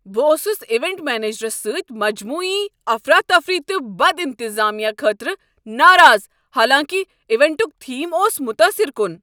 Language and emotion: Kashmiri, angry